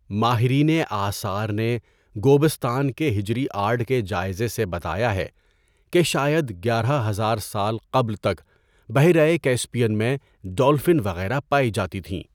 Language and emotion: Urdu, neutral